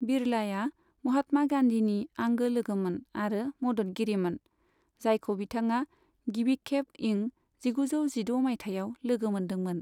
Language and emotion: Bodo, neutral